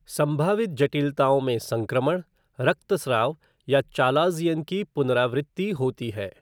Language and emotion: Hindi, neutral